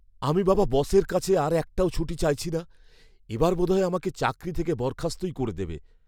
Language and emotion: Bengali, fearful